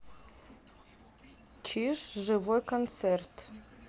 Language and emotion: Russian, neutral